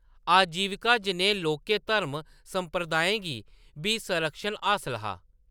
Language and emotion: Dogri, neutral